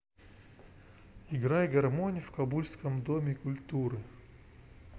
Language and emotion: Russian, neutral